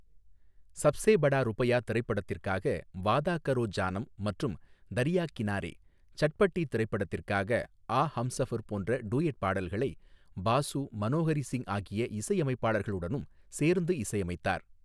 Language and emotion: Tamil, neutral